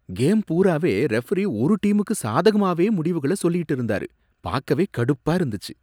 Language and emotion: Tamil, disgusted